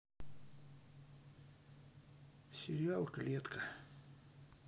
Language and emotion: Russian, sad